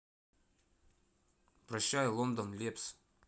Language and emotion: Russian, neutral